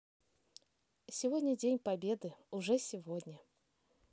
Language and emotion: Russian, positive